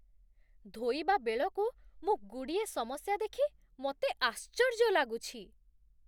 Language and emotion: Odia, surprised